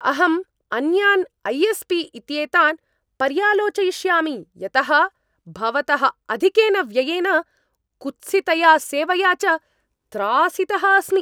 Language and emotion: Sanskrit, angry